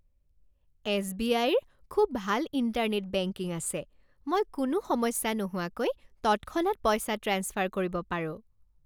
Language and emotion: Assamese, happy